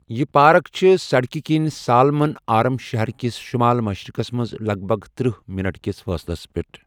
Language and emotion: Kashmiri, neutral